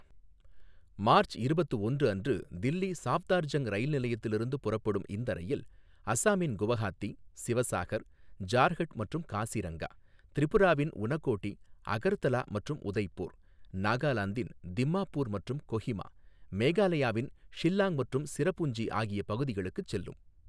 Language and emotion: Tamil, neutral